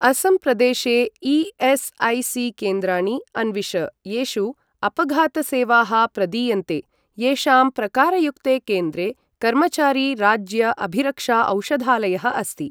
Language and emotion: Sanskrit, neutral